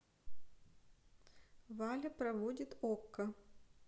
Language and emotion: Russian, neutral